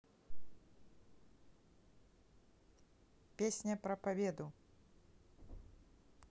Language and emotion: Russian, neutral